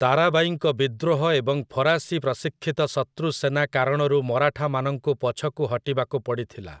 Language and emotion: Odia, neutral